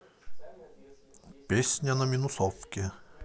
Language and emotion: Russian, positive